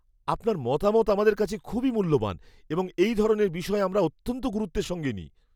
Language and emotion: Bengali, fearful